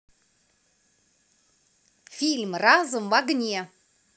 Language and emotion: Russian, neutral